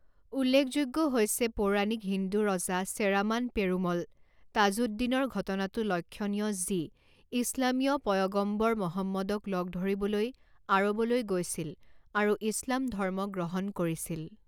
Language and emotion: Assamese, neutral